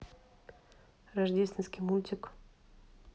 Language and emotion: Russian, neutral